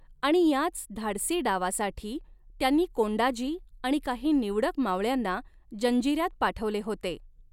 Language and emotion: Marathi, neutral